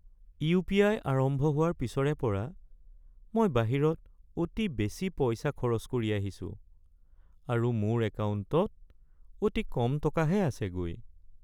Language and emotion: Assamese, sad